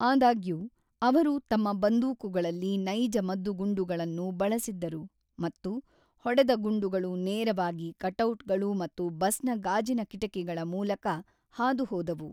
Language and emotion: Kannada, neutral